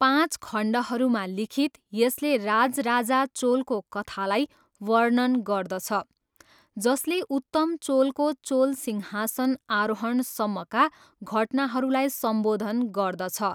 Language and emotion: Nepali, neutral